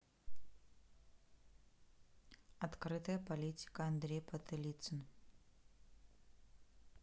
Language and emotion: Russian, neutral